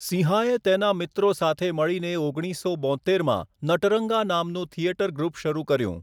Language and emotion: Gujarati, neutral